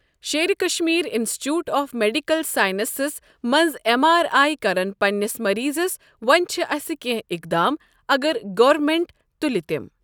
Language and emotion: Kashmiri, neutral